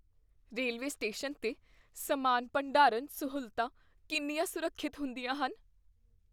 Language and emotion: Punjabi, fearful